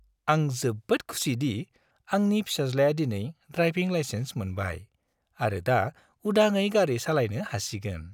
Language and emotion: Bodo, happy